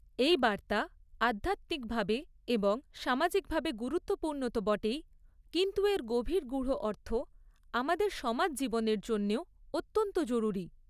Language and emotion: Bengali, neutral